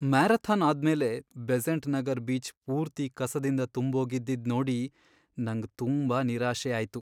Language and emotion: Kannada, sad